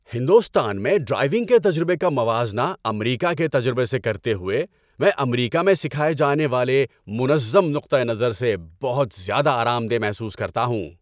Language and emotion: Urdu, happy